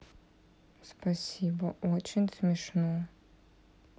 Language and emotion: Russian, sad